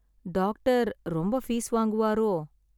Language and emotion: Tamil, sad